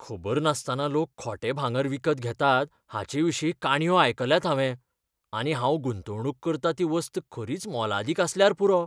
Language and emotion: Goan Konkani, fearful